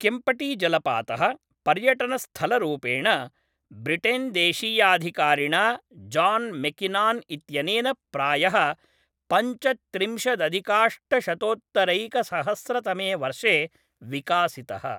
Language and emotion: Sanskrit, neutral